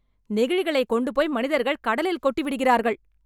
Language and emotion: Tamil, angry